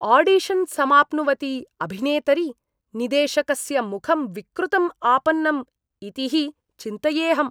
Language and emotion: Sanskrit, disgusted